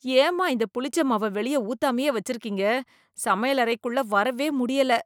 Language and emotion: Tamil, disgusted